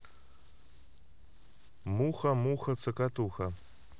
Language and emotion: Russian, positive